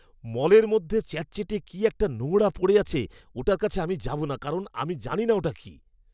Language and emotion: Bengali, disgusted